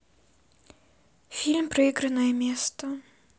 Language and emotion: Russian, sad